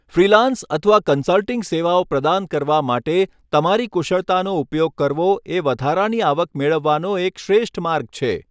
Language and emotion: Gujarati, neutral